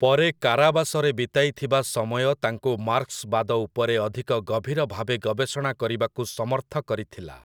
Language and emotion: Odia, neutral